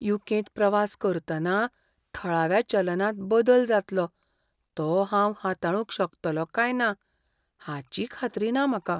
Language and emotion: Goan Konkani, fearful